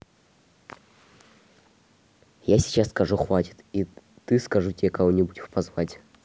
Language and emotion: Russian, neutral